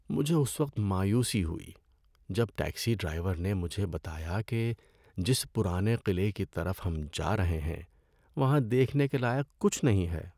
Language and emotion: Urdu, sad